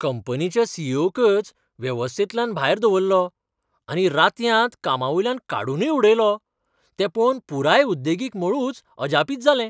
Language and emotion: Goan Konkani, surprised